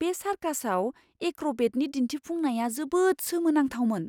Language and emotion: Bodo, surprised